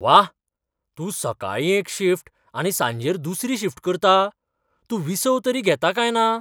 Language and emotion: Goan Konkani, surprised